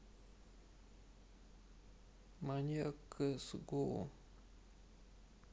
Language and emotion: Russian, sad